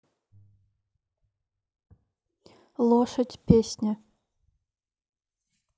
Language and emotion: Russian, neutral